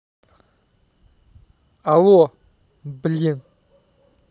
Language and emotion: Russian, angry